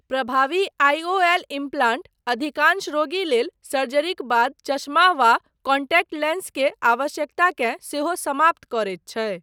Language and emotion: Maithili, neutral